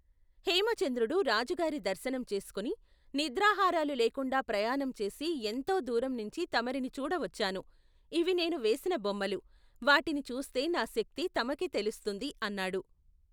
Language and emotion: Telugu, neutral